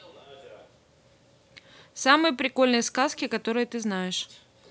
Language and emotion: Russian, neutral